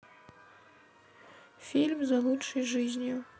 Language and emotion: Russian, neutral